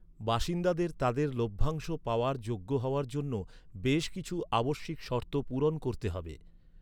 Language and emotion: Bengali, neutral